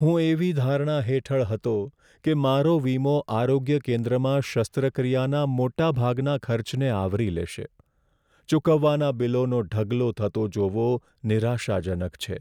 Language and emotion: Gujarati, sad